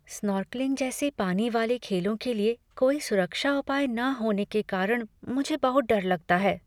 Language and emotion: Hindi, fearful